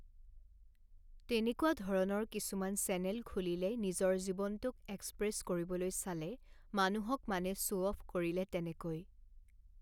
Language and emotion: Assamese, neutral